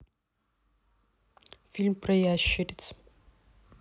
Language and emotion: Russian, neutral